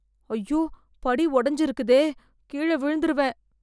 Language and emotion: Tamil, fearful